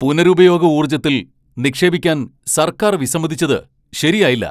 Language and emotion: Malayalam, angry